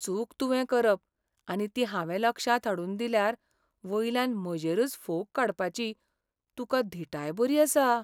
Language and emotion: Goan Konkani, sad